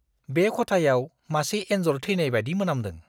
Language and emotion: Bodo, disgusted